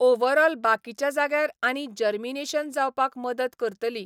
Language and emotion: Goan Konkani, neutral